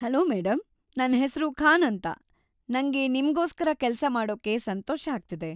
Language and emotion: Kannada, happy